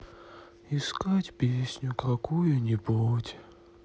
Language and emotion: Russian, sad